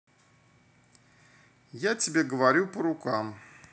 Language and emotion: Russian, neutral